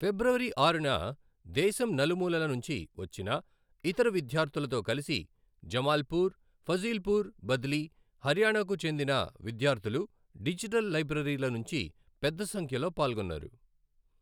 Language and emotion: Telugu, neutral